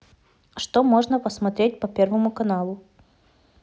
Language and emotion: Russian, neutral